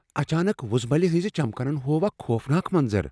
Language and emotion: Kashmiri, fearful